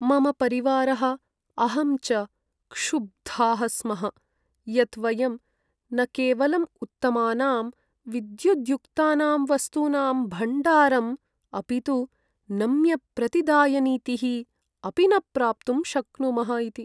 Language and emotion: Sanskrit, sad